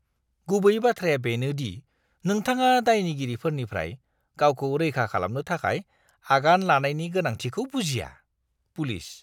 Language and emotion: Bodo, disgusted